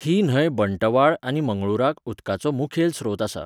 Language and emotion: Goan Konkani, neutral